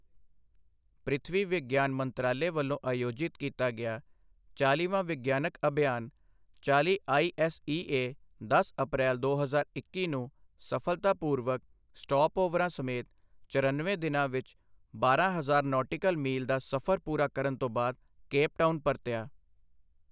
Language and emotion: Punjabi, neutral